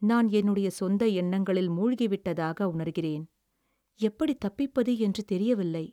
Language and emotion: Tamil, sad